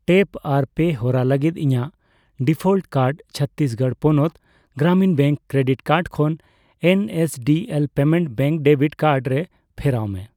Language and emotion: Santali, neutral